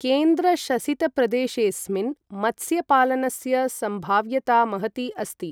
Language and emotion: Sanskrit, neutral